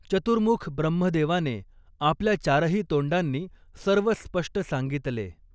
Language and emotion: Marathi, neutral